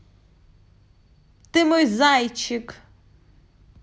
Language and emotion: Russian, positive